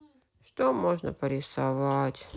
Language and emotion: Russian, sad